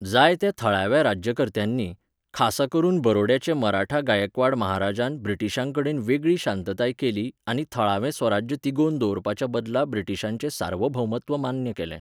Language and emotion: Goan Konkani, neutral